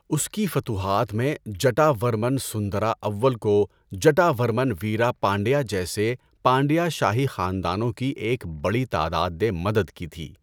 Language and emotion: Urdu, neutral